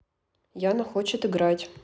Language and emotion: Russian, neutral